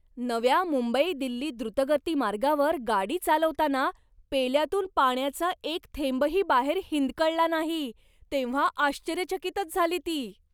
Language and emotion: Marathi, surprised